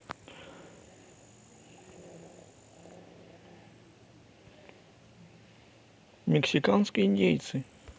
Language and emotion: Russian, neutral